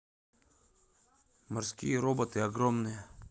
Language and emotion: Russian, neutral